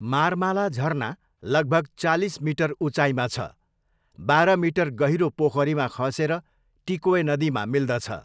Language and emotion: Nepali, neutral